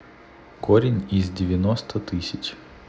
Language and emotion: Russian, neutral